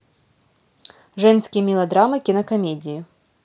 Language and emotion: Russian, neutral